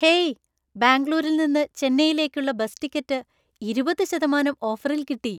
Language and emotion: Malayalam, happy